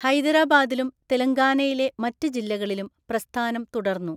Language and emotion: Malayalam, neutral